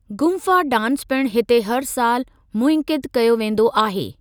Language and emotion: Sindhi, neutral